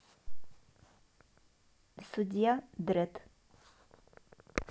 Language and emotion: Russian, neutral